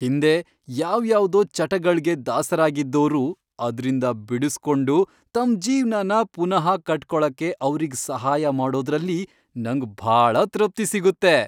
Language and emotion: Kannada, happy